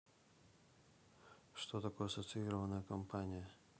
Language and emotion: Russian, neutral